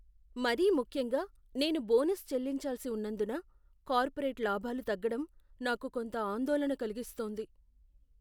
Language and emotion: Telugu, fearful